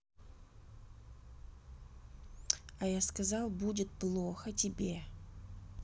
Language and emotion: Russian, angry